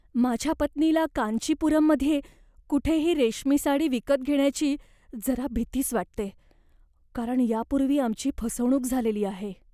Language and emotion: Marathi, fearful